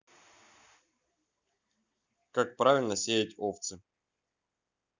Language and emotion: Russian, neutral